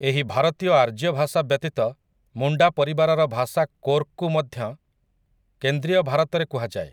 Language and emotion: Odia, neutral